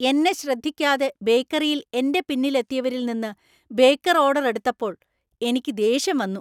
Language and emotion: Malayalam, angry